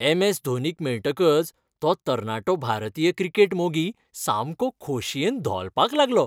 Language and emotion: Goan Konkani, happy